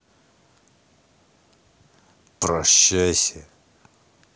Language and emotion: Russian, angry